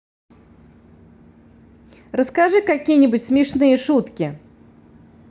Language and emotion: Russian, positive